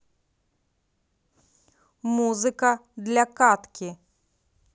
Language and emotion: Russian, neutral